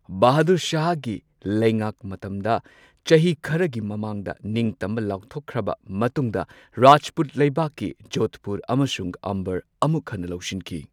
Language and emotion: Manipuri, neutral